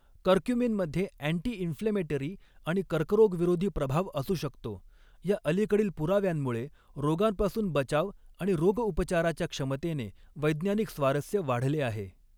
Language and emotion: Marathi, neutral